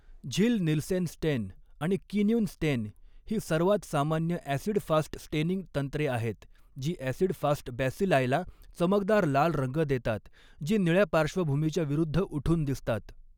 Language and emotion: Marathi, neutral